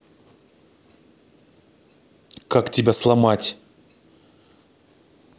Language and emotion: Russian, angry